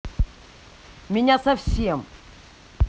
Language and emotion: Russian, angry